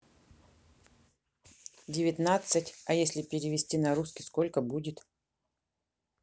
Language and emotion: Russian, neutral